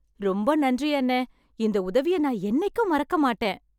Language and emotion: Tamil, happy